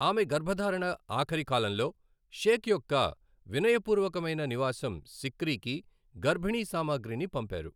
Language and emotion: Telugu, neutral